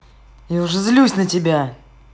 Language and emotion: Russian, angry